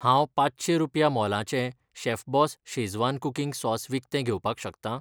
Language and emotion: Goan Konkani, neutral